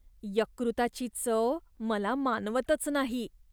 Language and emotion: Marathi, disgusted